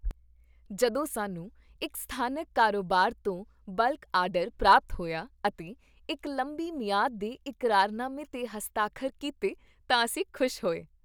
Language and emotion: Punjabi, happy